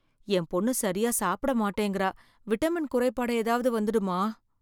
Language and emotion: Tamil, fearful